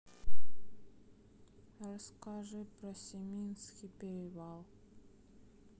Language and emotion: Russian, sad